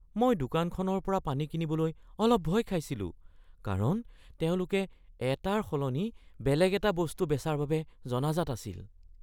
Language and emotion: Assamese, fearful